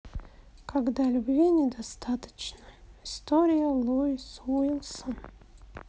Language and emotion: Russian, sad